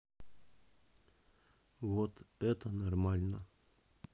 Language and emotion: Russian, neutral